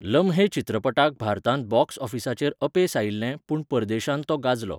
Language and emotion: Goan Konkani, neutral